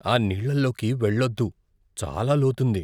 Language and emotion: Telugu, fearful